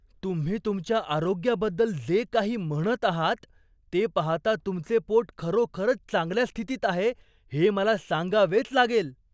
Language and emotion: Marathi, surprised